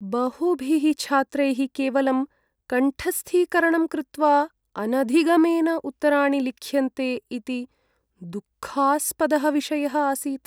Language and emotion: Sanskrit, sad